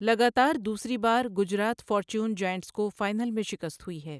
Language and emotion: Urdu, neutral